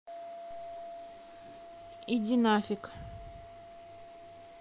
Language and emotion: Russian, neutral